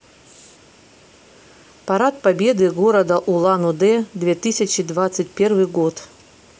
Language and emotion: Russian, neutral